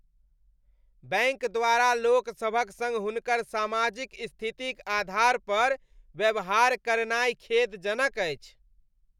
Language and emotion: Maithili, disgusted